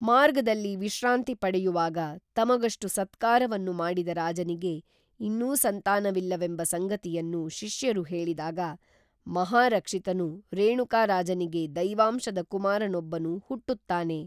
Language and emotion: Kannada, neutral